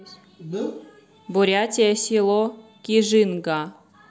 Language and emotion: Russian, neutral